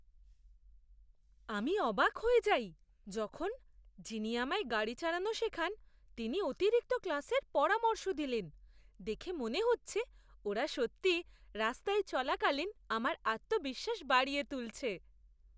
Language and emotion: Bengali, surprised